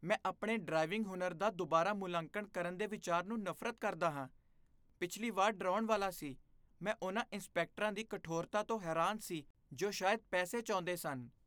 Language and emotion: Punjabi, disgusted